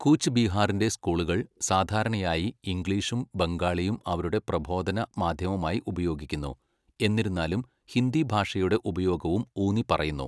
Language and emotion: Malayalam, neutral